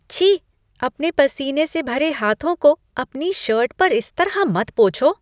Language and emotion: Hindi, disgusted